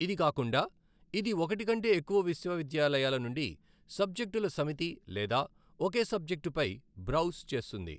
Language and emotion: Telugu, neutral